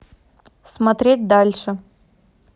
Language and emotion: Russian, neutral